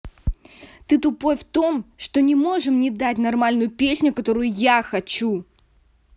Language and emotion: Russian, angry